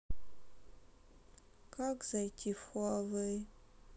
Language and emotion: Russian, sad